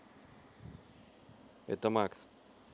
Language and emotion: Russian, neutral